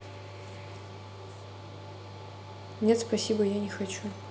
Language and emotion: Russian, neutral